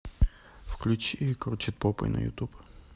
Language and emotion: Russian, neutral